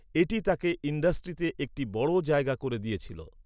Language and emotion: Bengali, neutral